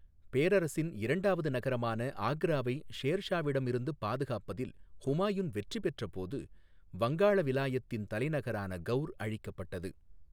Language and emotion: Tamil, neutral